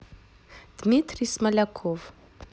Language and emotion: Russian, neutral